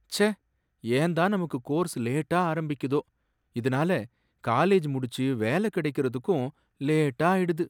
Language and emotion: Tamil, sad